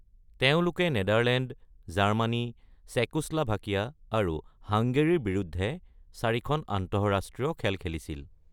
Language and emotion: Assamese, neutral